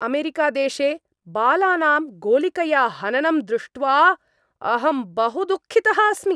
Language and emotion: Sanskrit, angry